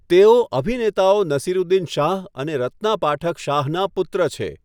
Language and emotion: Gujarati, neutral